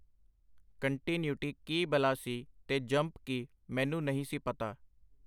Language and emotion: Punjabi, neutral